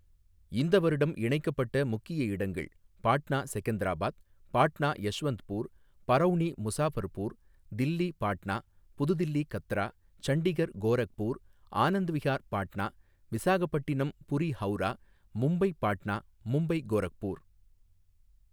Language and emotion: Tamil, neutral